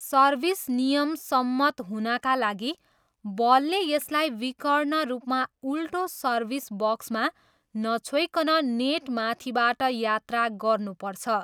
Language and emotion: Nepali, neutral